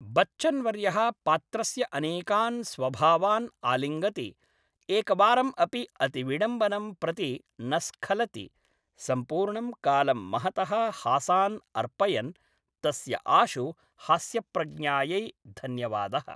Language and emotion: Sanskrit, neutral